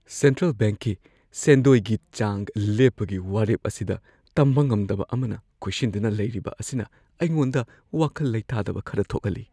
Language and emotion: Manipuri, fearful